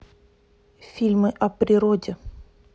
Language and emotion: Russian, neutral